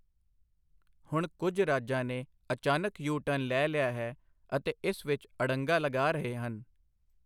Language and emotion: Punjabi, neutral